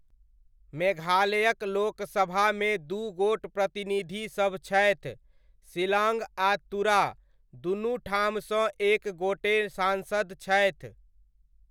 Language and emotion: Maithili, neutral